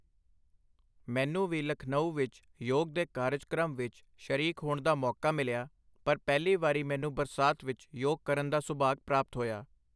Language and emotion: Punjabi, neutral